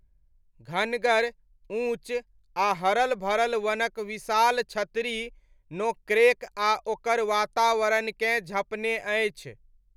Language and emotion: Maithili, neutral